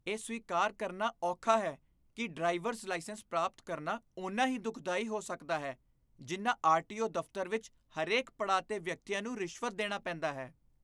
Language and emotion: Punjabi, disgusted